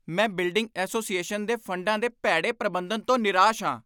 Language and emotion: Punjabi, angry